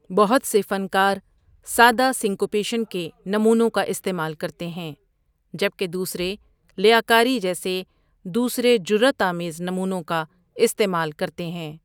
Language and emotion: Urdu, neutral